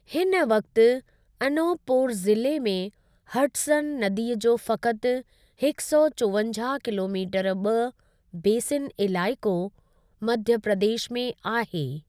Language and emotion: Sindhi, neutral